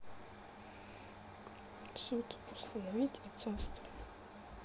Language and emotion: Russian, sad